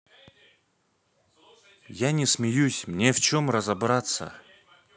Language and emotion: Russian, neutral